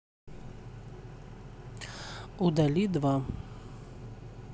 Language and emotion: Russian, neutral